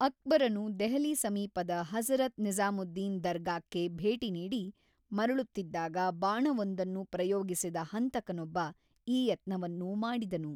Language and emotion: Kannada, neutral